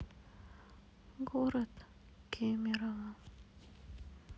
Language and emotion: Russian, sad